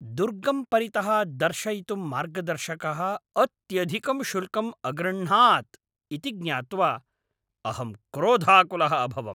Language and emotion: Sanskrit, angry